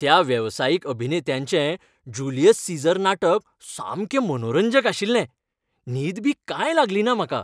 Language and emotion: Goan Konkani, happy